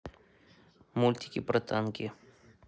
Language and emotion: Russian, neutral